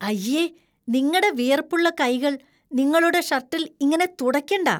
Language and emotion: Malayalam, disgusted